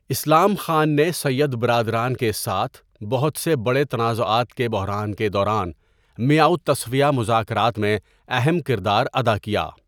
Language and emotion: Urdu, neutral